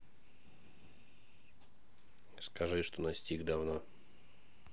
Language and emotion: Russian, neutral